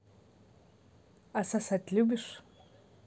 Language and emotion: Russian, neutral